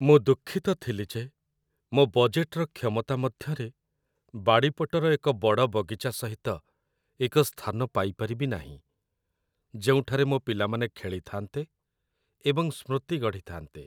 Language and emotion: Odia, sad